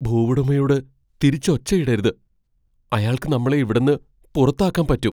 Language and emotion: Malayalam, fearful